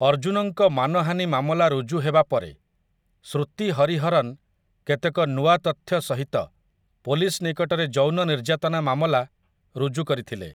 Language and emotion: Odia, neutral